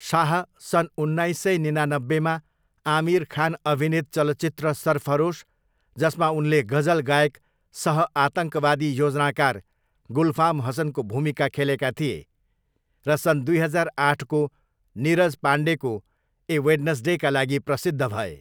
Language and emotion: Nepali, neutral